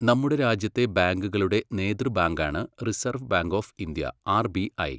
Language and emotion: Malayalam, neutral